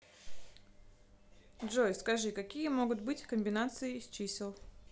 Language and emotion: Russian, neutral